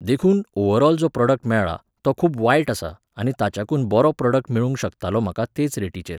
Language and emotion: Goan Konkani, neutral